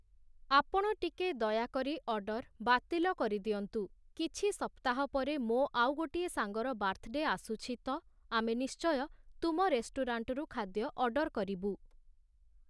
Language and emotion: Odia, neutral